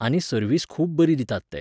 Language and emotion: Goan Konkani, neutral